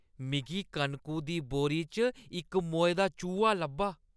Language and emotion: Dogri, disgusted